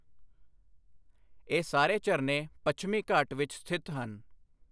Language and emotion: Punjabi, neutral